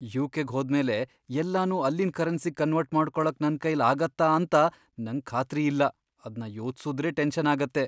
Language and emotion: Kannada, fearful